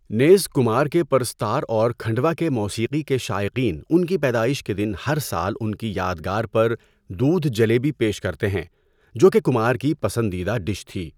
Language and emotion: Urdu, neutral